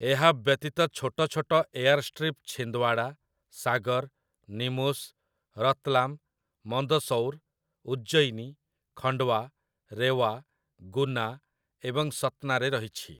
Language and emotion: Odia, neutral